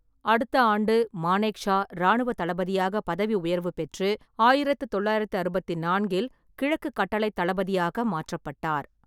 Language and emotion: Tamil, neutral